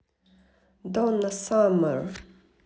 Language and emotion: Russian, neutral